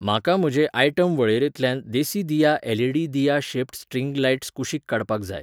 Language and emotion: Goan Konkani, neutral